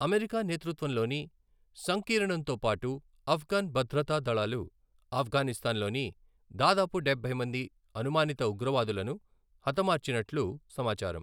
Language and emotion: Telugu, neutral